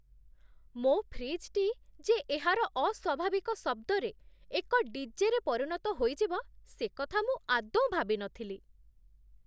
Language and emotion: Odia, surprised